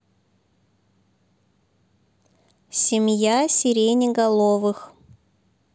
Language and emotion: Russian, neutral